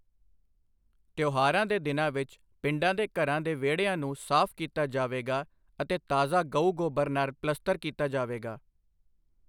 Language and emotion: Punjabi, neutral